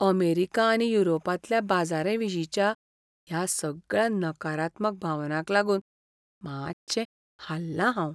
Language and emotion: Goan Konkani, fearful